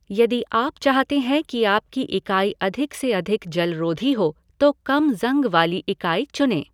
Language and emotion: Hindi, neutral